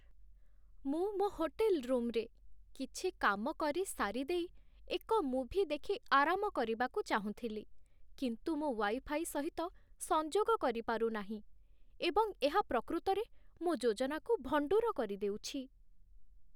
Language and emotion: Odia, sad